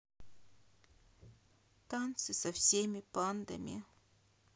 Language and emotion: Russian, sad